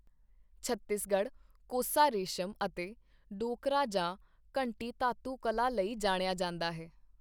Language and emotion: Punjabi, neutral